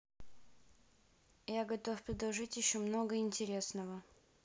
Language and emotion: Russian, neutral